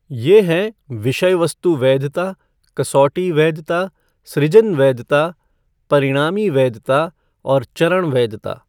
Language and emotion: Hindi, neutral